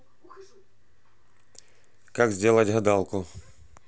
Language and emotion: Russian, neutral